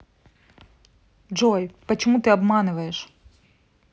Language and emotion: Russian, angry